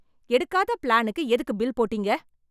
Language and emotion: Tamil, angry